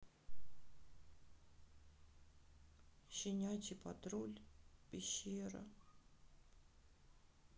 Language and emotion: Russian, sad